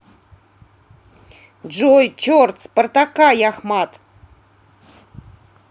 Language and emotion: Russian, angry